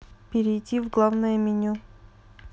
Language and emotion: Russian, neutral